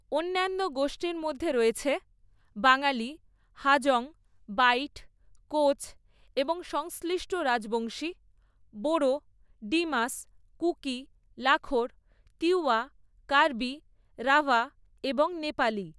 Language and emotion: Bengali, neutral